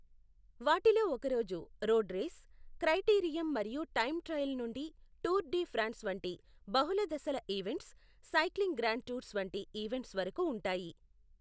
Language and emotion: Telugu, neutral